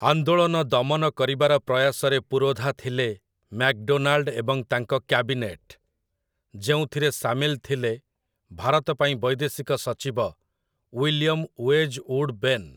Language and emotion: Odia, neutral